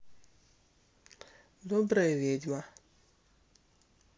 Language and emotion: Russian, neutral